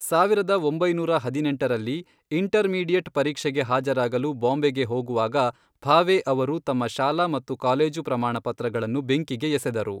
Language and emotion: Kannada, neutral